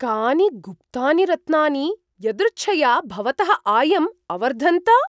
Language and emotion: Sanskrit, surprised